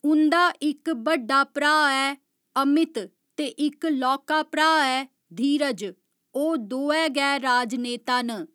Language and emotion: Dogri, neutral